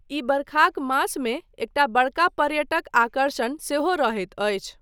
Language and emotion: Maithili, neutral